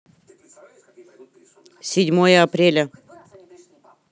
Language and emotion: Russian, neutral